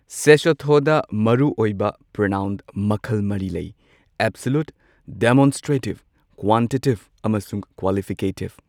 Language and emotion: Manipuri, neutral